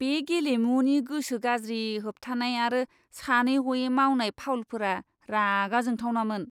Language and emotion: Bodo, disgusted